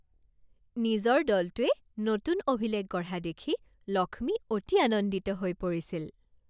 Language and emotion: Assamese, happy